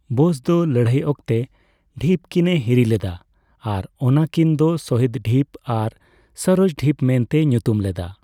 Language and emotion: Santali, neutral